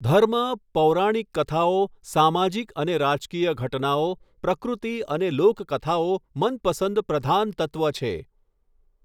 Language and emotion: Gujarati, neutral